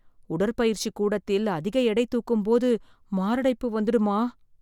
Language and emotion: Tamil, fearful